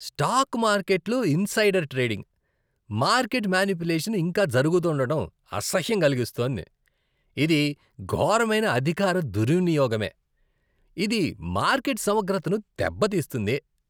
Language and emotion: Telugu, disgusted